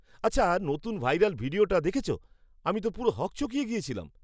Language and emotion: Bengali, surprised